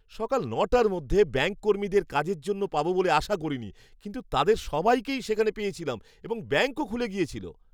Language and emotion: Bengali, surprised